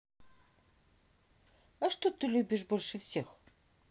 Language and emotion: Russian, neutral